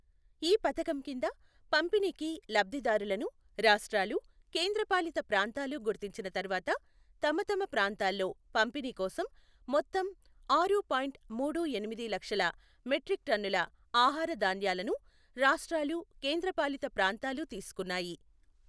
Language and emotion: Telugu, neutral